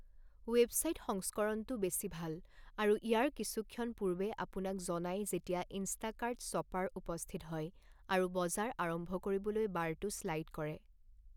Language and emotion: Assamese, neutral